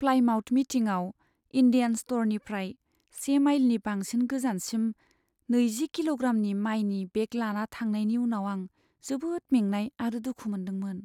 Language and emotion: Bodo, sad